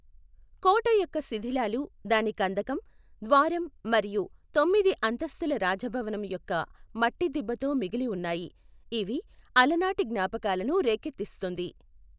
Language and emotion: Telugu, neutral